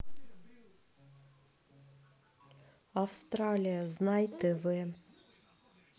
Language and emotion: Russian, neutral